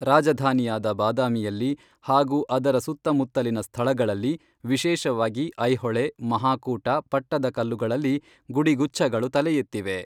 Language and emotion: Kannada, neutral